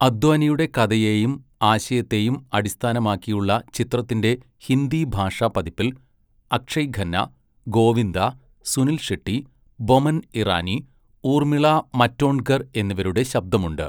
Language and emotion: Malayalam, neutral